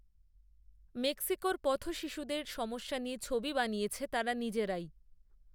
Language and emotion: Bengali, neutral